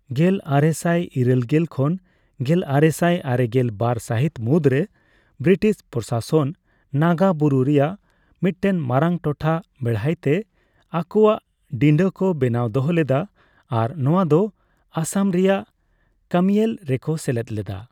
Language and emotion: Santali, neutral